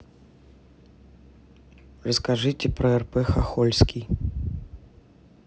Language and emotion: Russian, neutral